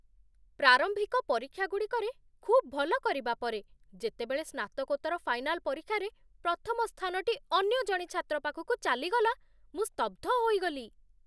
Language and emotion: Odia, surprised